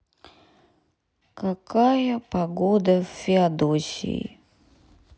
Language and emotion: Russian, sad